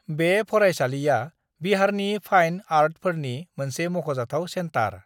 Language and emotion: Bodo, neutral